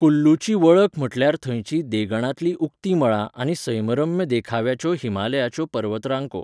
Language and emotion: Goan Konkani, neutral